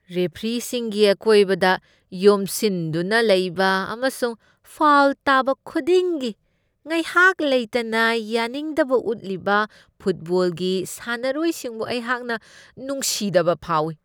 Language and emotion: Manipuri, disgusted